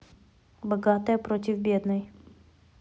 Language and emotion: Russian, neutral